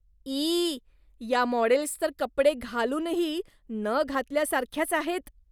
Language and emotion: Marathi, disgusted